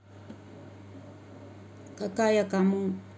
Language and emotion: Russian, neutral